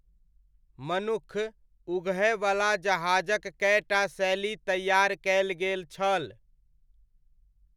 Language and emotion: Maithili, neutral